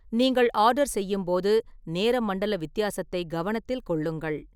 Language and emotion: Tamil, neutral